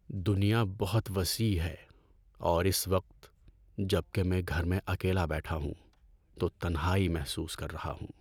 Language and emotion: Urdu, sad